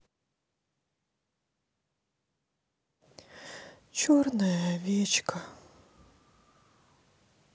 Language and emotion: Russian, sad